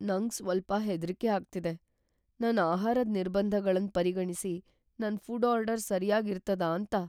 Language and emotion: Kannada, fearful